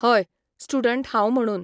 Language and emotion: Goan Konkani, neutral